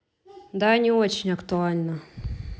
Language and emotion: Russian, neutral